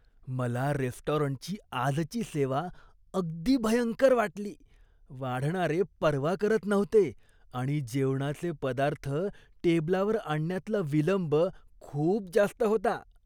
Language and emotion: Marathi, disgusted